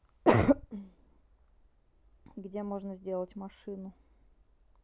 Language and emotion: Russian, neutral